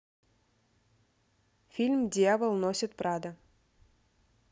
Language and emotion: Russian, neutral